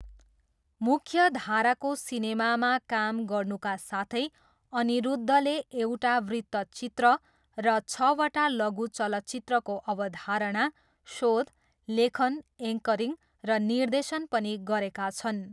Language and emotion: Nepali, neutral